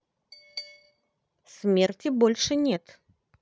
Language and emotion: Russian, neutral